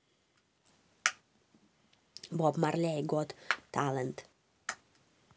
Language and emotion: Russian, neutral